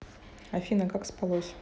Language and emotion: Russian, neutral